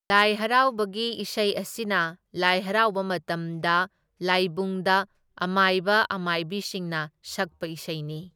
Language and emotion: Manipuri, neutral